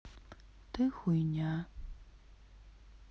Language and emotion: Russian, sad